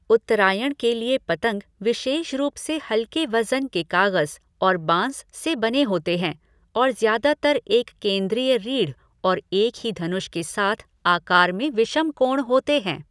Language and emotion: Hindi, neutral